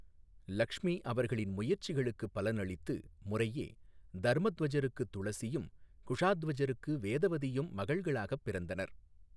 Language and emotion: Tamil, neutral